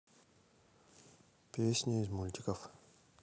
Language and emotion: Russian, neutral